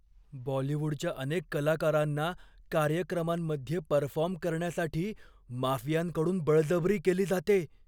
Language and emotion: Marathi, fearful